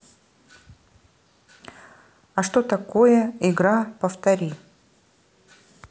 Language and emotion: Russian, neutral